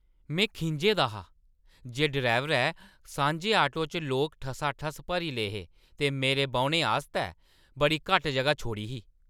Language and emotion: Dogri, angry